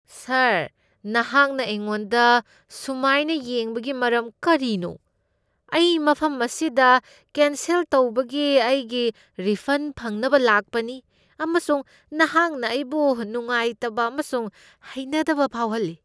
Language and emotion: Manipuri, disgusted